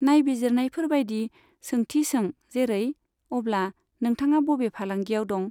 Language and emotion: Bodo, neutral